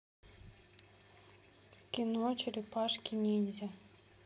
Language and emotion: Russian, neutral